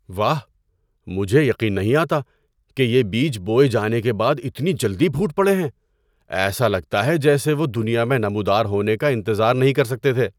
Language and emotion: Urdu, surprised